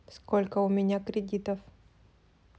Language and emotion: Russian, neutral